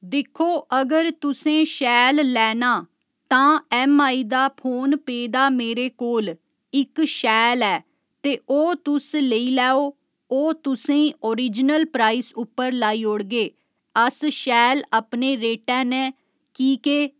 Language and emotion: Dogri, neutral